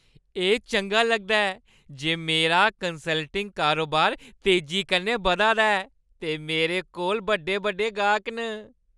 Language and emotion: Dogri, happy